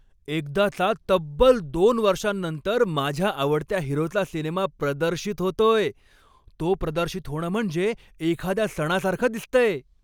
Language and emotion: Marathi, happy